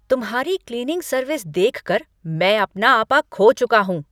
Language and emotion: Hindi, angry